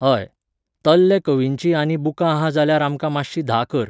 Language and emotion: Goan Konkani, neutral